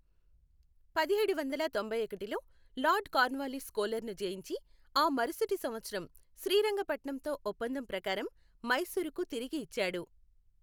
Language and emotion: Telugu, neutral